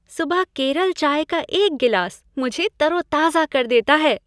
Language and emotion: Hindi, happy